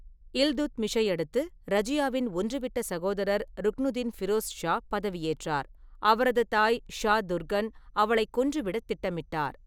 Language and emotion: Tamil, neutral